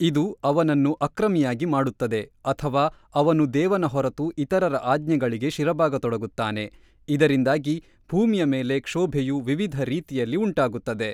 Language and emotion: Kannada, neutral